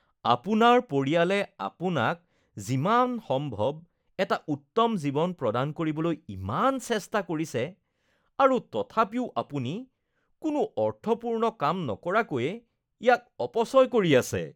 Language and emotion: Assamese, disgusted